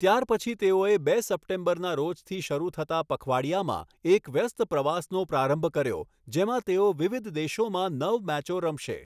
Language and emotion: Gujarati, neutral